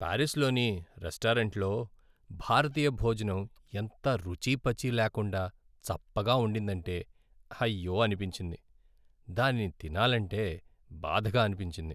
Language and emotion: Telugu, sad